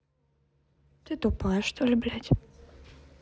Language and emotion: Russian, neutral